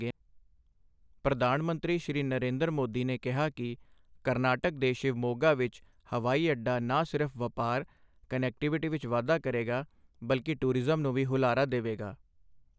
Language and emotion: Punjabi, neutral